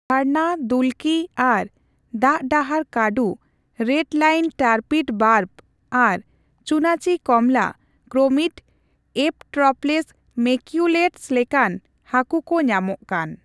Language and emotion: Santali, neutral